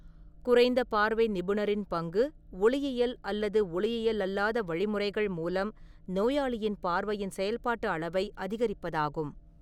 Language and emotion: Tamil, neutral